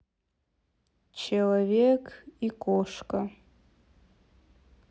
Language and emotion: Russian, neutral